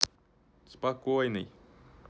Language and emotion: Russian, neutral